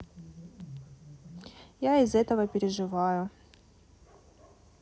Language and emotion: Russian, neutral